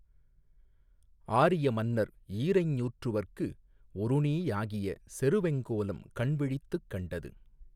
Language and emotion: Tamil, neutral